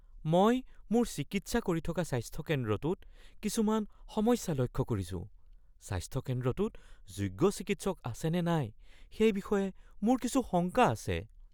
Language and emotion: Assamese, fearful